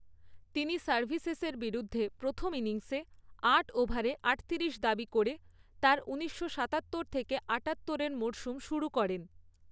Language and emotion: Bengali, neutral